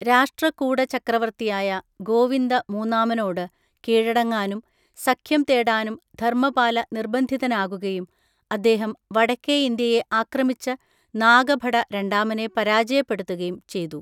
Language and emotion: Malayalam, neutral